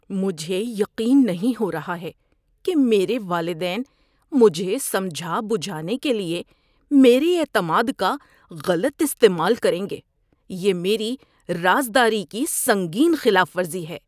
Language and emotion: Urdu, disgusted